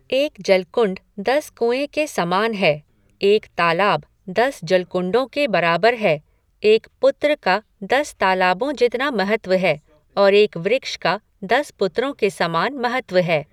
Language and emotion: Hindi, neutral